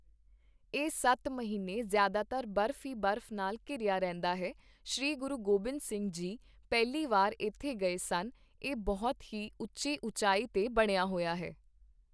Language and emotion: Punjabi, neutral